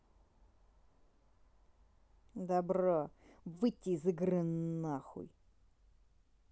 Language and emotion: Russian, angry